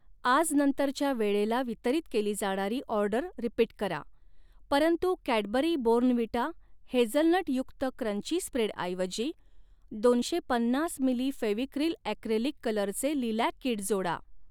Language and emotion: Marathi, neutral